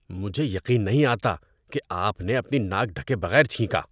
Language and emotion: Urdu, disgusted